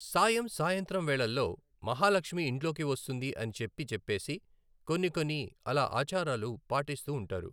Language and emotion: Telugu, neutral